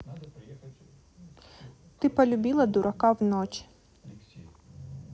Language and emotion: Russian, neutral